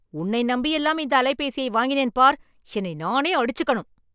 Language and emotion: Tamil, angry